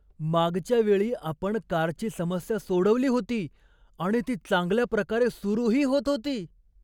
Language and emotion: Marathi, surprised